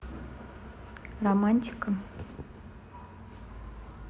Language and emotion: Russian, neutral